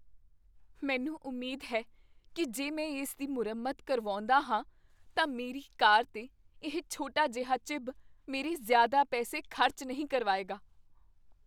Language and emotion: Punjabi, fearful